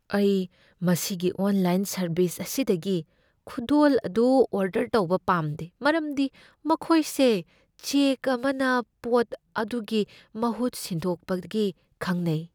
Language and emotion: Manipuri, fearful